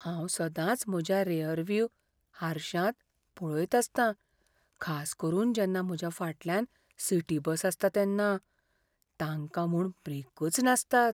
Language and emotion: Goan Konkani, fearful